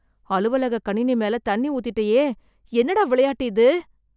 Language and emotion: Tamil, fearful